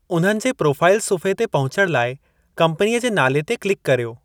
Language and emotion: Sindhi, neutral